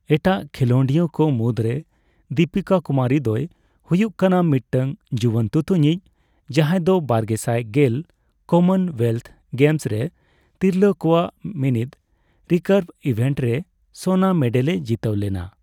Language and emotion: Santali, neutral